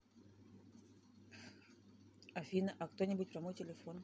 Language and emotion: Russian, neutral